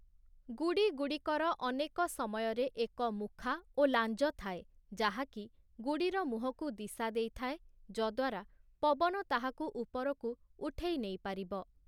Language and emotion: Odia, neutral